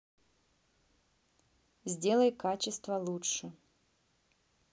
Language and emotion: Russian, neutral